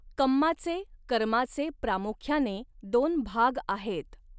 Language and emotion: Marathi, neutral